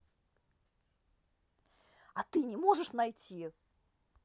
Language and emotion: Russian, angry